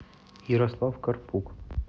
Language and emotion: Russian, neutral